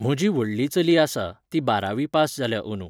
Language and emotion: Goan Konkani, neutral